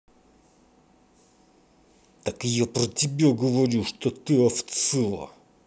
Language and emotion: Russian, angry